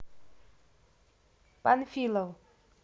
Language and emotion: Russian, neutral